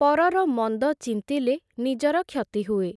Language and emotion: Odia, neutral